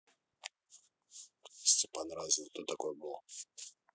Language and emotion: Russian, neutral